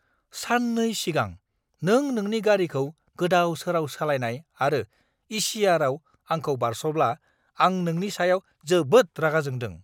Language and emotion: Bodo, angry